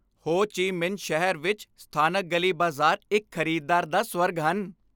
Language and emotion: Punjabi, happy